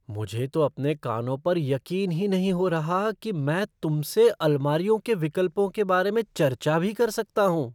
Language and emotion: Hindi, surprised